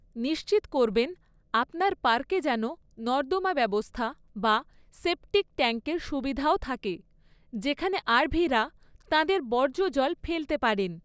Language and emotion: Bengali, neutral